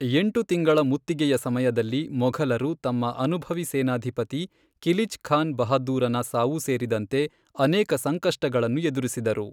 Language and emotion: Kannada, neutral